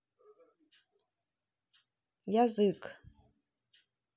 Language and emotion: Russian, neutral